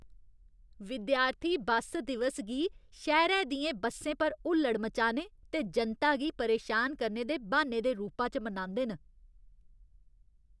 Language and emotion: Dogri, disgusted